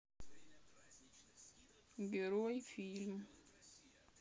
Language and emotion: Russian, sad